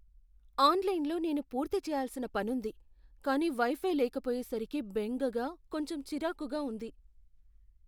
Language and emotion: Telugu, fearful